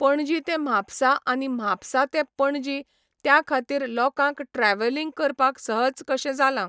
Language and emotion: Goan Konkani, neutral